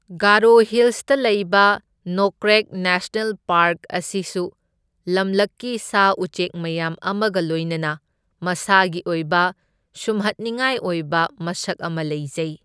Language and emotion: Manipuri, neutral